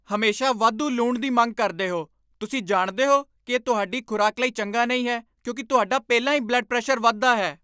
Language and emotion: Punjabi, angry